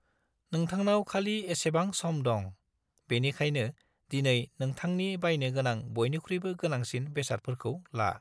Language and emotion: Bodo, neutral